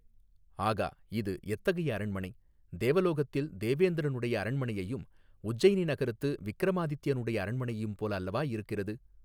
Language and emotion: Tamil, neutral